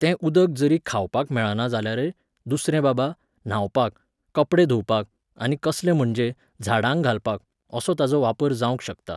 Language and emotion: Goan Konkani, neutral